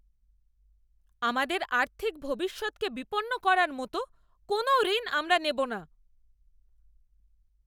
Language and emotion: Bengali, angry